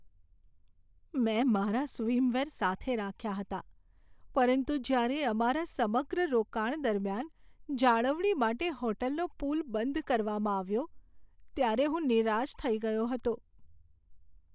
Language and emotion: Gujarati, sad